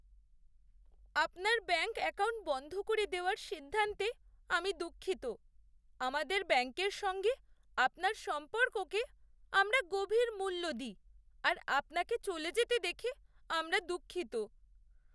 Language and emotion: Bengali, sad